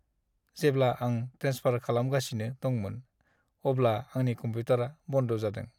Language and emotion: Bodo, sad